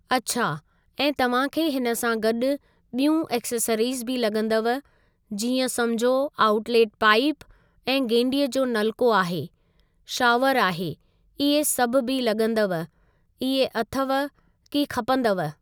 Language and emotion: Sindhi, neutral